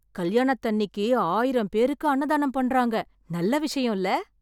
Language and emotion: Tamil, surprised